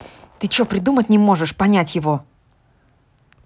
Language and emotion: Russian, angry